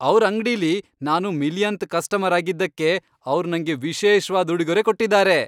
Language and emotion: Kannada, happy